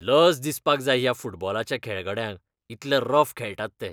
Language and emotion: Goan Konkani, disgusted